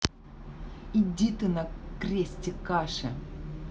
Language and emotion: Russian, angry